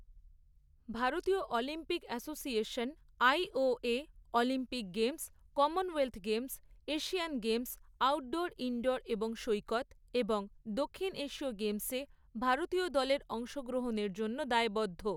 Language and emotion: Bengali, neutral